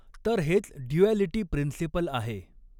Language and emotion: Marathi, neutral